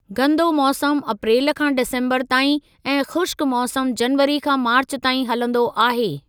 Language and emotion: Sindhi, neutral